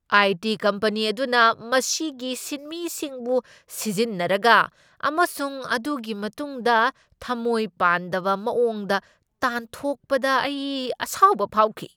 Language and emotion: Manipuri, angry